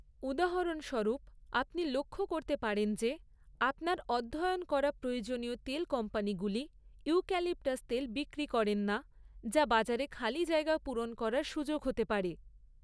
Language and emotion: Bengali, neutral